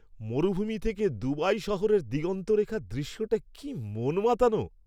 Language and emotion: Bengali, happy